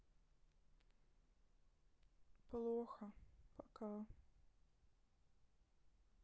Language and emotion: Russian, sad